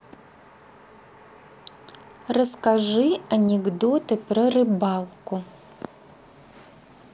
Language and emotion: Russian, neutral